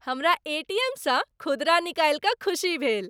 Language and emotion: Maithili, happy